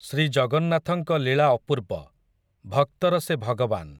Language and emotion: Odia, neutral